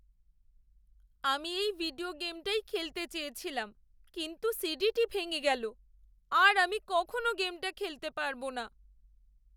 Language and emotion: Bengali, sad